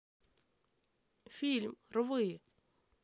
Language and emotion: Russian, neutral